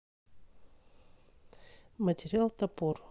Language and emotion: Russian, neutral